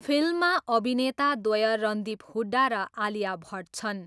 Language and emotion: Nepali, neutral